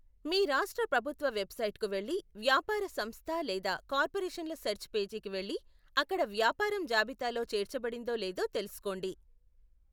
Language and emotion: Telugu, neutral